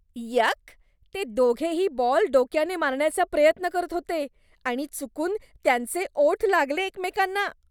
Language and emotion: Marathi, disgusted